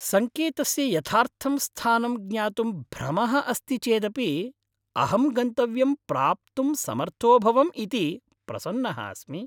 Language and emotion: Sanskrit, happy